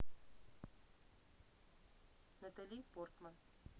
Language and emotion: Russian, neutral